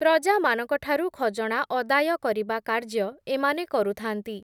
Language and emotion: Odia, neutral